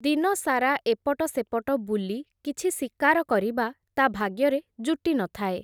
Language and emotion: Odia, neutral